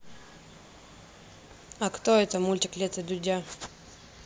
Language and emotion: Russian, neutral